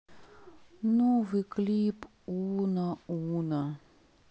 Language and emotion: Russian, sad